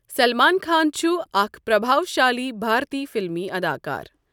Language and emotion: Kashmiri, neutral